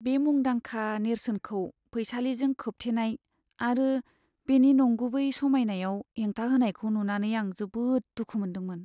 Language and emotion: Bodo, sad